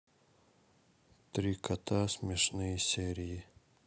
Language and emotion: Russian, neutral